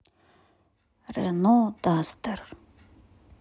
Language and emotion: Russian, neutral